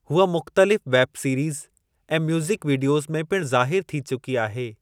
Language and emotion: Sindhi, neutral